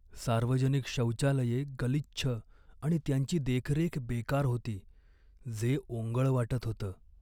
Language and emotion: Marathi, sad